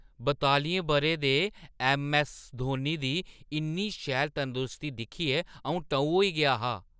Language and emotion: Dogri, surprised